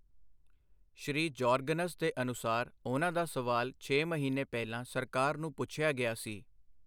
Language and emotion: Punjabi, neutral